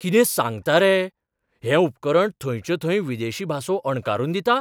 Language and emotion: Goan Konkani, surprised